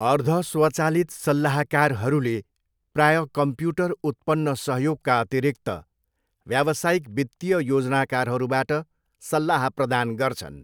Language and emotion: Nepali, neutral